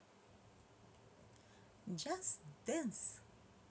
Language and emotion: Russian, positive